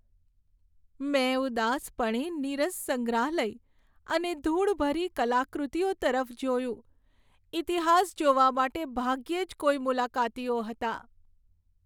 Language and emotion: Gujarati, sad